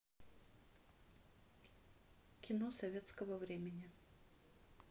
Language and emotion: Russian, neutral